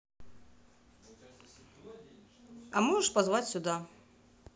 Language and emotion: Russian, neutral